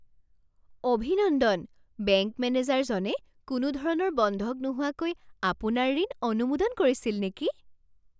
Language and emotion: Assamese, surprised